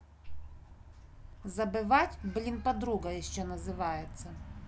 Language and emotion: Russian, angry